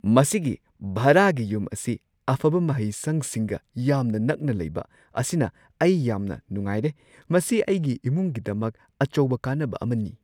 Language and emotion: Manipuri, surprised